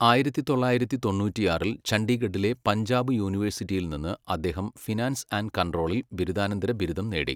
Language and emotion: Malayalam, neutral